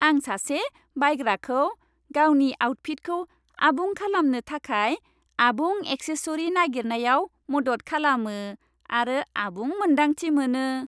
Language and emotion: Bodo, happy